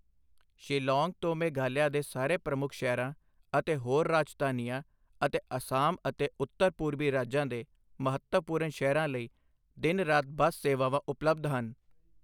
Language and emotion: Punjabi, neutral